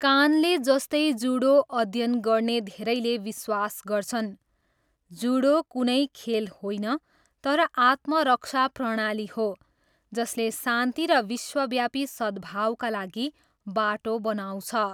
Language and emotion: Nepali, neutral